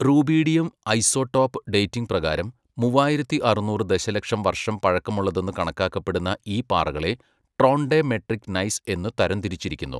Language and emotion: Malayalam, neutral